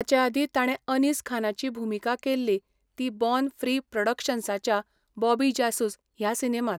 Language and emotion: Goan Konkani, neutral